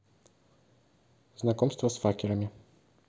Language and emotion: Russian, neutral